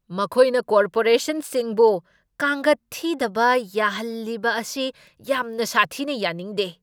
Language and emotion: Manipuri, angry